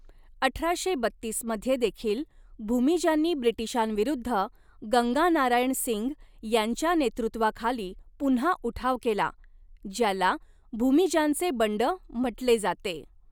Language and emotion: Marathi, neutral